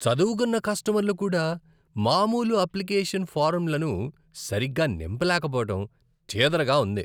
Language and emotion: Telugu, disgusted